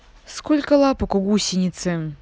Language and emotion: Russian, angry